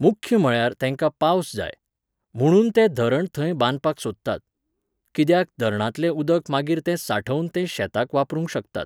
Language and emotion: Goan Konkani, neutral